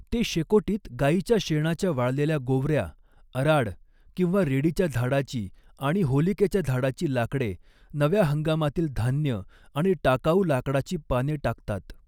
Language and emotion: Marathi, neutral